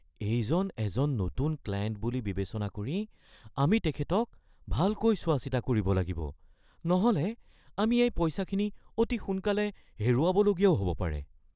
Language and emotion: Assamese, fearful